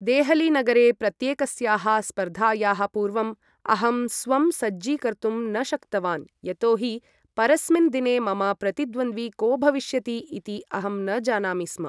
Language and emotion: Sanskrit, neutral